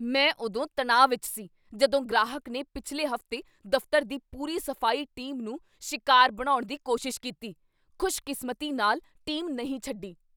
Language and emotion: Punjabi, angry